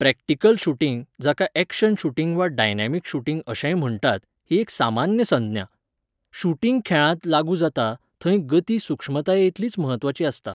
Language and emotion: Goan Konkani, neutral